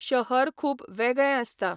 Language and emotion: Goan Konkani, neutral